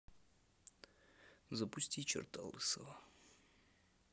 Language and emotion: Russian, neutral